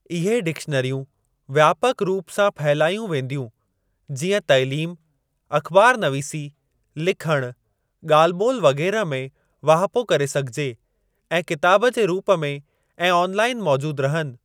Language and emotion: Sindhi, neutral